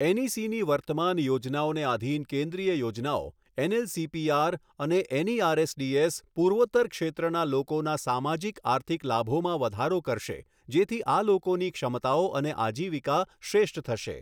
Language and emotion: Gujarati, neutral